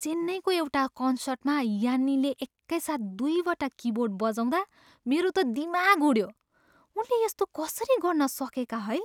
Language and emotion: Nepali, surprised